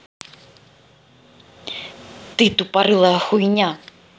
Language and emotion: Russian, angry